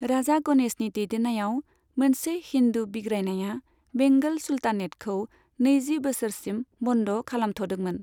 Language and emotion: Bodo, neutral